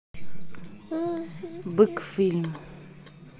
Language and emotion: Russian, neutral